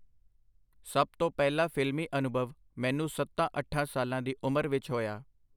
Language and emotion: Punjabi, neutral